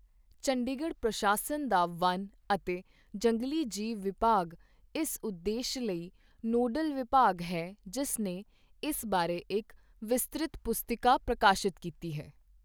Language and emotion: Punjabi, neutral